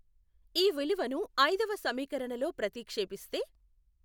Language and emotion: Telugu, neutral